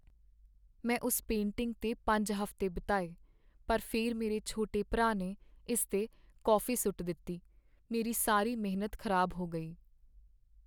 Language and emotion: Punjabi, sad